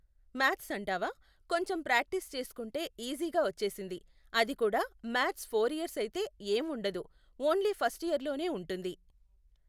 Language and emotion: Telugu, neutral